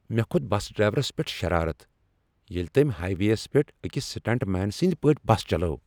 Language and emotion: Kashmiri, angry